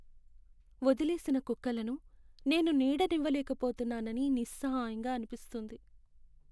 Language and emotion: Telugu, sad